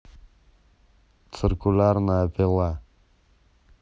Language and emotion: Russian, neutral